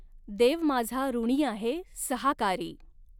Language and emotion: Marathi, neutral